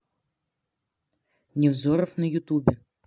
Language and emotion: Russian, neutral